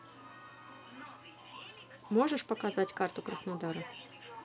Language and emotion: Russian, neutral